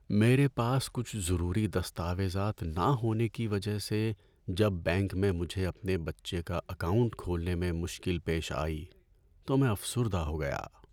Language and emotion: Urdu, sad